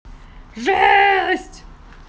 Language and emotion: Russian, angry